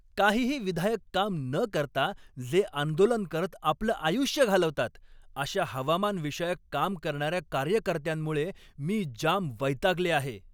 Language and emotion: Marathi, angry